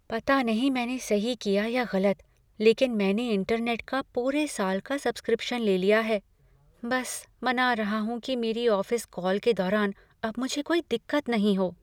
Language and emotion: Hindi, fearful